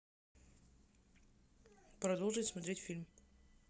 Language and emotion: Russian, neutral